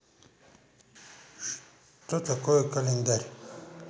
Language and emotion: Russian, neutral